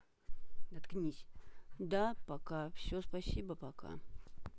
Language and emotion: Russian, neutral